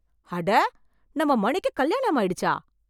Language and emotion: Tamil, surprised